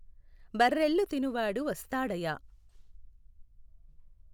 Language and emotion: Telugu, neutral